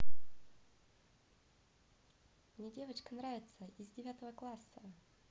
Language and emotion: Russian, positive